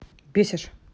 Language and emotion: Russian, angry